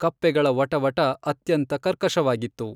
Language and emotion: Kannada, neutral